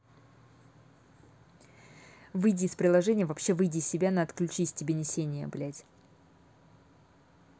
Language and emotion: Russian, angry